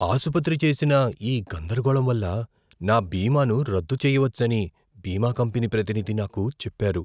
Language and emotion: Telugu, fearful